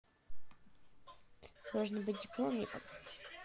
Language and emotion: Russian, neutral